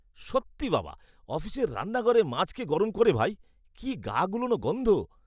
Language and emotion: Bengali, disgusted